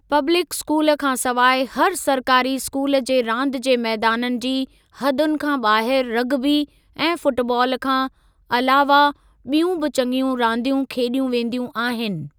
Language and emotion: Sindhi, neutral